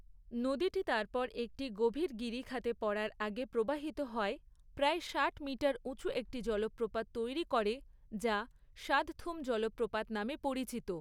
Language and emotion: Bengali, neutral